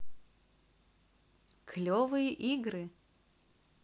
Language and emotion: Russian, positive